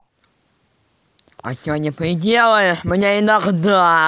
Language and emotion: Russian, angry